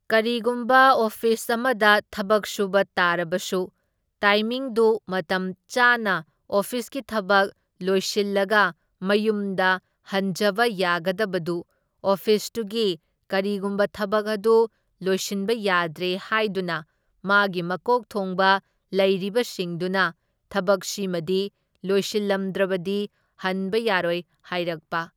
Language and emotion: Manipuri, neutral